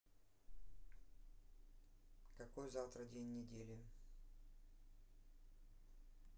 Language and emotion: Russian, neutral